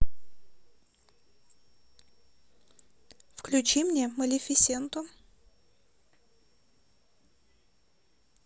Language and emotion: Russian, neutral